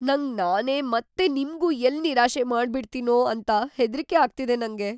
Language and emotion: Kannada, fearful